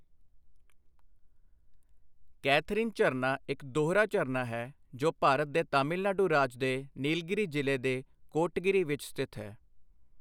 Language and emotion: Punjabi, neutral